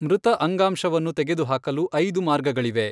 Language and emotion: Kannada, neutral